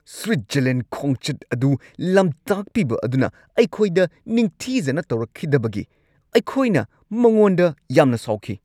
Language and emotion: Manipuri, angry